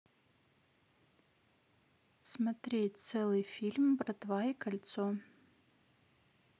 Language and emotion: Russian, neutral